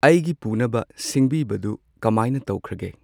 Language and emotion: Manipuri, neutral